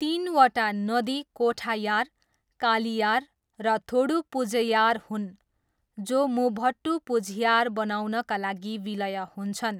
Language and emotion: Nepali, neutral